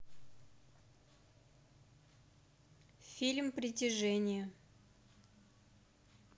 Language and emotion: Russian, neutral